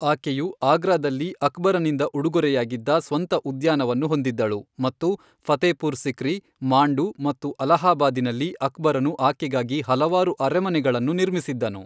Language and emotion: Kannada, neutral